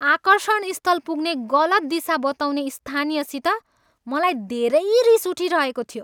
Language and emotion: Nepali, angry